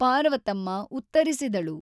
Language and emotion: Kannada, neutral